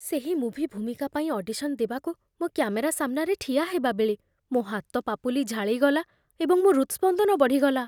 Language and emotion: Odia, fearful